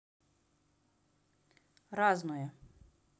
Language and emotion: Russian, neutral